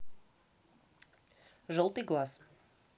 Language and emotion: Russian, neutral